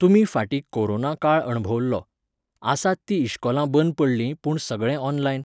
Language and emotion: Goan Konkani, neutral